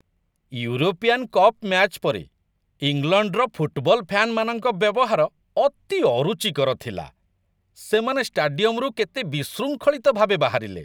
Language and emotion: Odia, disgusted